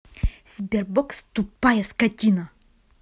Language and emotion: Russian, angry